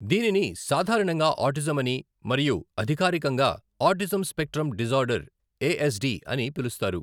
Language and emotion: Telugu, neutral